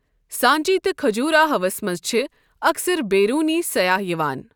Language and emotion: Kashmiri, neutral